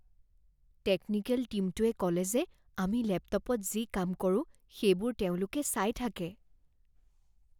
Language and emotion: Assamese, fearful